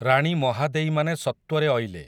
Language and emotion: Odia, neutral